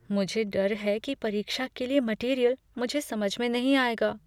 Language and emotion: Hindi, fearful